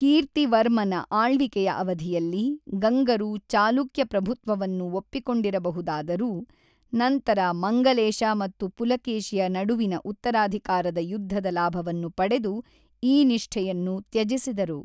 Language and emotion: Kannada, neutral